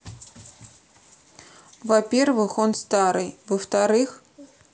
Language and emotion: Russian, neutral